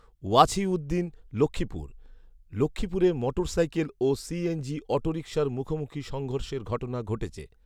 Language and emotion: Bengali, neutral